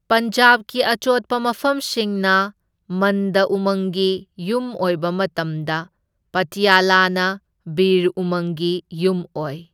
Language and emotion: Manipuri, neutral